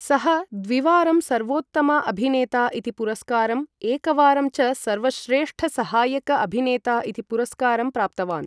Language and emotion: Sanskrit, neutral